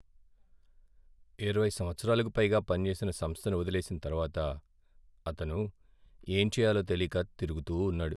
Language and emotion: Telugu, sad